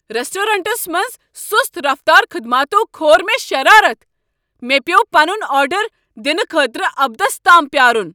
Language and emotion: Kashmiri, angry